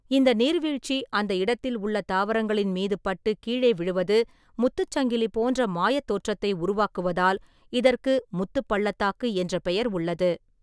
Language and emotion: Tamil, neutral